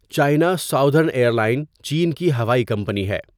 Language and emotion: Urdu, neutral